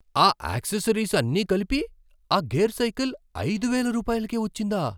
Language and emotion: Telugu, surprised